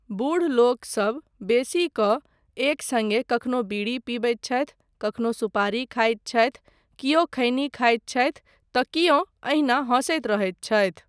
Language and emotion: Maithili, neutral